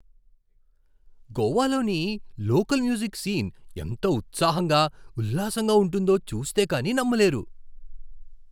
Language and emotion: Telugu, surprised